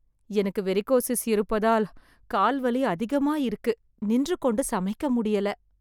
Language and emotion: Tamil, sad